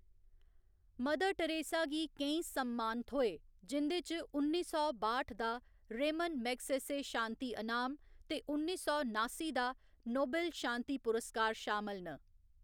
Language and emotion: Dogri, neutral